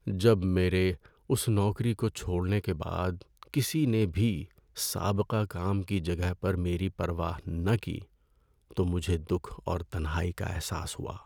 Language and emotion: Urdu, sad